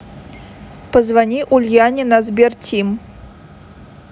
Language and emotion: Russian, neutral